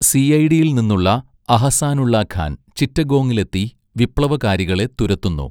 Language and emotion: Malayalam, neutral